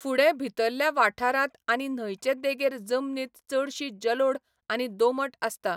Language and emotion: Goan Konkani, neutral